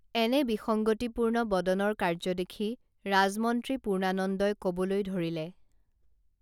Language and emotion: Assamese, neutral